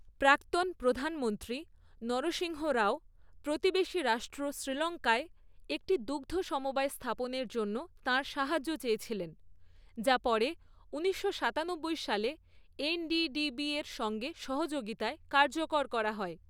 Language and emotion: Bengali, neutral